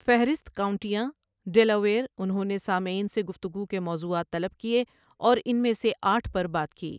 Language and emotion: Urdu, neutral